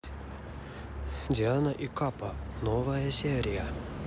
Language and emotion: Russian, neutral